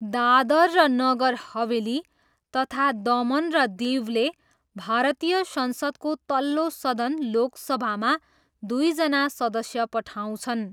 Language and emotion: Nepali, neutral